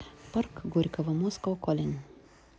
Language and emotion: Russian, neutral